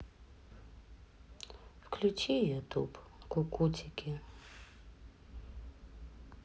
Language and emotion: Russian, sad